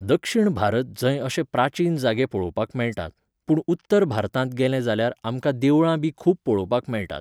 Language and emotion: Goan Konkani, neutral